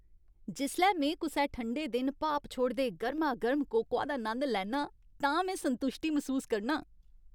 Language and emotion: Dogri, happy